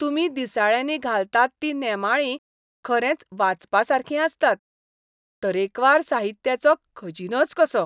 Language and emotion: Goan Konkani, happy